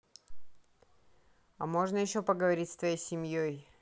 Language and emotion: Russian, neutral